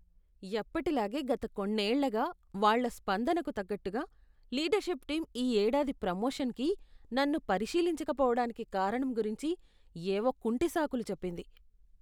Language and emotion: Telugu, disgusted